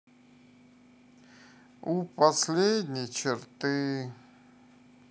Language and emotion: Russian, sad